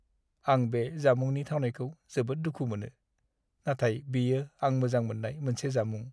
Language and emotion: Bodo, sad